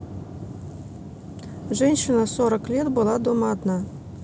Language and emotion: Russian, neutral